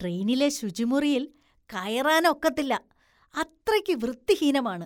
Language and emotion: Malayalam, disgusted